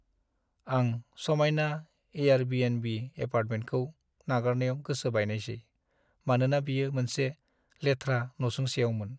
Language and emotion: Bodo, sad